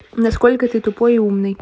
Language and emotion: Russian, neutral